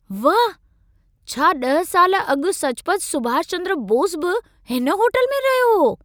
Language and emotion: Sindhi, surprised